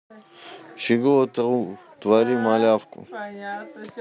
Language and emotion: Russian, neutral